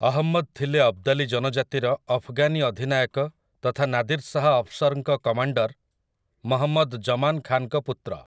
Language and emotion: Odia, neutral